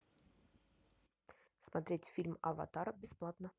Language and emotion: Russian, neutral